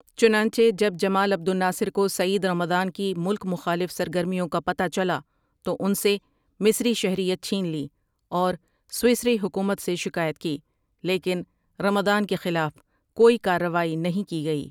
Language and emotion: Urdu, neutral